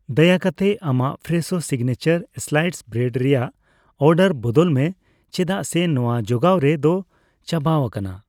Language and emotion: Santali, neutral